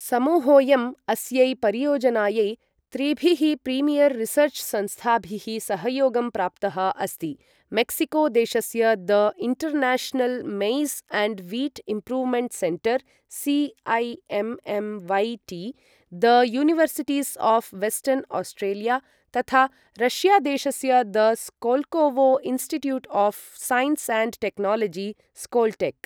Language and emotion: Sanskrit, neutral